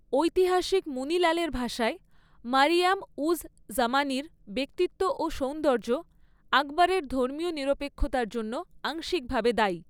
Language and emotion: Bengali, neutral